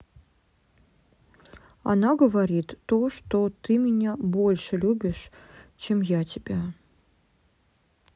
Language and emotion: Russian, sad